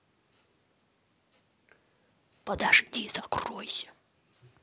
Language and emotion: Russian, angry